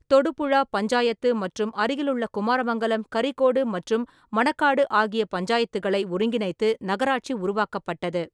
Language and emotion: Tamil, neutral